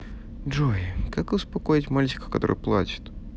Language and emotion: Russian, neutral